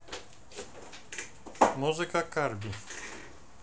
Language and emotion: Russian, neutral